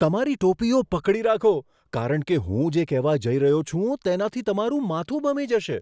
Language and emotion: Gujarati, surprised